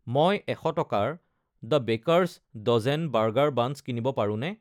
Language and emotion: Assamese, neutral